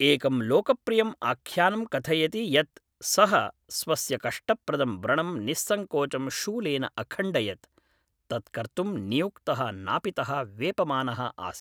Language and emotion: Sanskrit, neutral